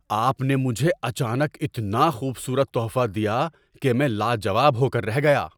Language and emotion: Urdu, surprised